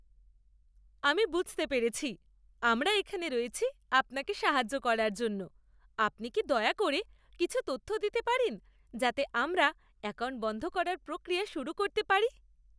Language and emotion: Bengali, happy